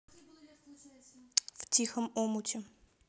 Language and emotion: Russian, neutral